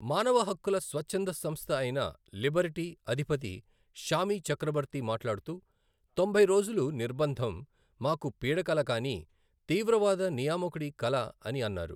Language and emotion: Telugu, neutral